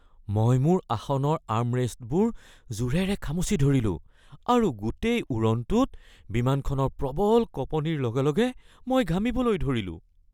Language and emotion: Assamese, fearful